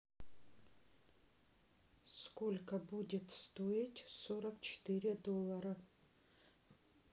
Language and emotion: Russian, neutral